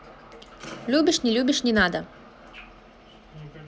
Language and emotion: Russian, positive